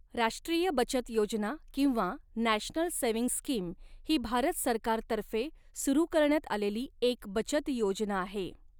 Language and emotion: Marathi, neutral